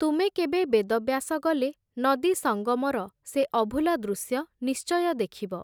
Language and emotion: Odia, neutral